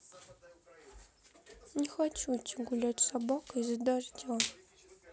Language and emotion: Russian, sad